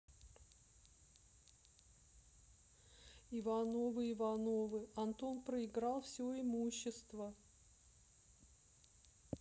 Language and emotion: Russian, sad